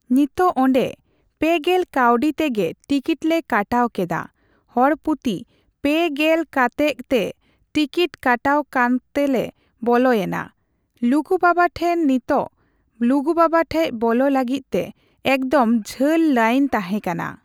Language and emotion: Santali, neutral